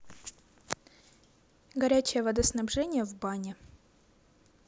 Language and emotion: Russian, neutral